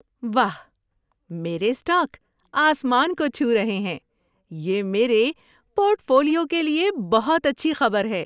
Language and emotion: Urdu, happy